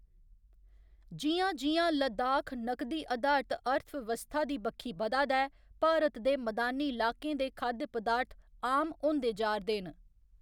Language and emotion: Dogri, neutral